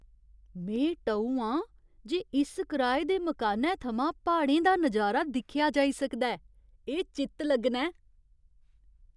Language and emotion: Dogri, surprised